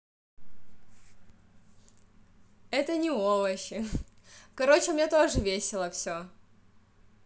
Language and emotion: Russian, positive